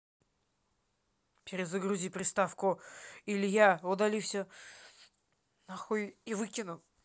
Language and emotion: Russian, angry